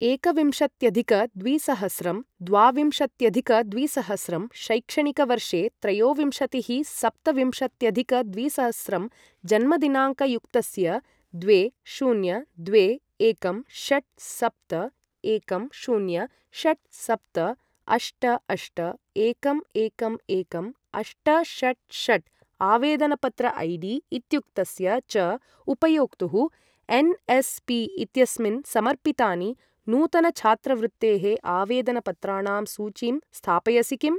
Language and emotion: Sanskrit, neutral